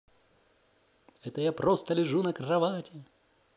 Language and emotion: Russian, positive